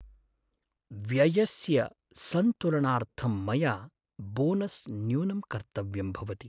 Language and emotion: Sanskrit, sad